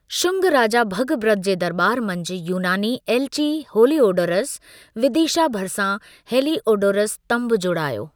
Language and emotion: Sindhi, neutral